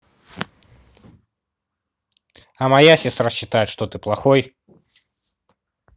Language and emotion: Russian, neutral